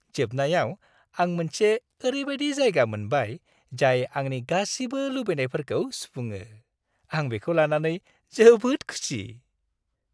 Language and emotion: Bodo, happy